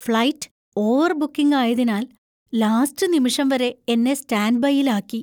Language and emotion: Malayalam, fearful